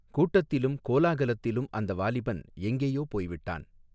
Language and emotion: Tamil, neutral